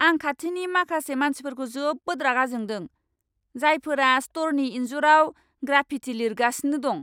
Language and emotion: Bodo, angry